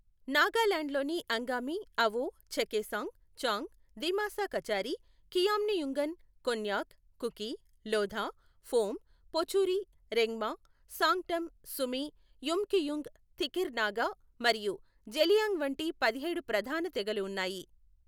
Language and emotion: Telugu, neutral